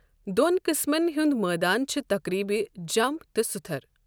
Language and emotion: Kashmiri, neutral